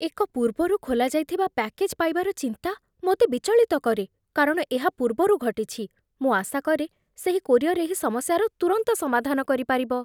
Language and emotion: Odia, fearful